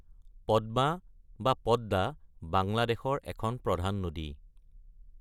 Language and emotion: Assamese, neutral